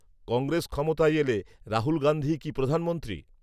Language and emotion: Bengali, neutral